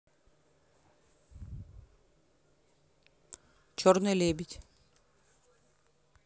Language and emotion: Russian, neutral